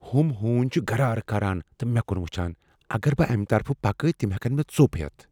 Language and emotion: Kashmiri, fearful